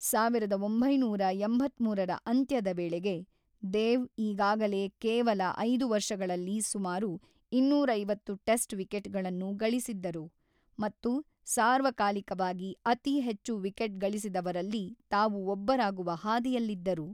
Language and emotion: Kannada, neutral